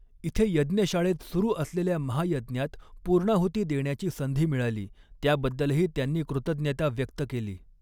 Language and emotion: Marathi, neutral